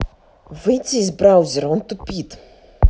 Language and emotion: Russian, angry